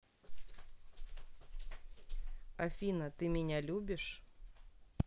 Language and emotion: Russian, neutral